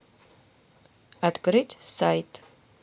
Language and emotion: Russian, neutral